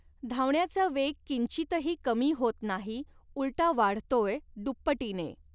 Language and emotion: Marathi, neutral